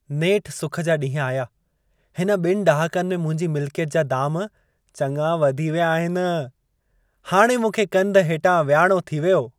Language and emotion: Sindhi, happy